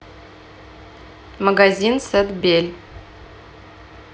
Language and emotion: Russian, neutral